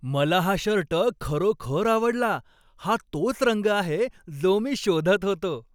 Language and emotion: Marathi, happy